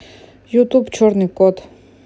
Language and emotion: Russian, neutral